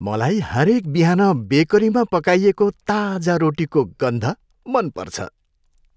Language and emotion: Nepali, happy